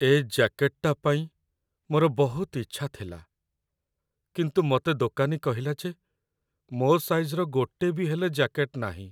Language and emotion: Odia, sad